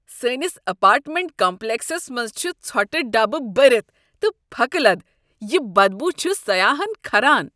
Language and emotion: Kashmiri, disgusted